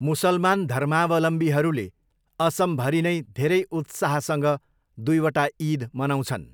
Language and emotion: Nepali, neutral